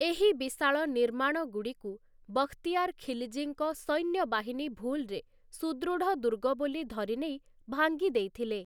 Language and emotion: Odia, neutral